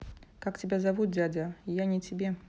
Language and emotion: Russian, neutral